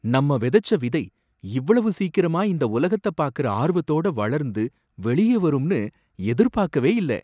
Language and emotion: Tamil, surprised